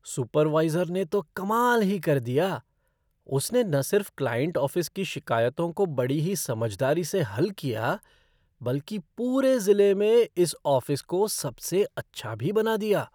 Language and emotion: Hindi, surprised